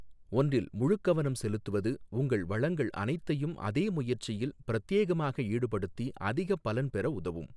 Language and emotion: Tamil, neutral